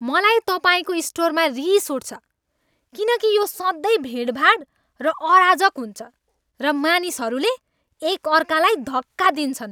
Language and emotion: Nepali, angry